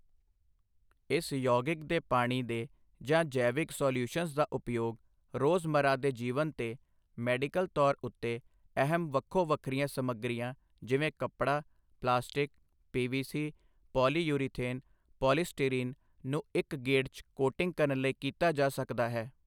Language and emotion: Punjabi, neutral